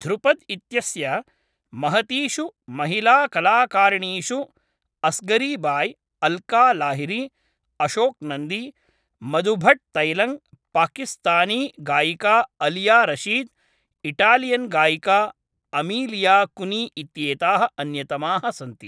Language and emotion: Sanskrit, neutral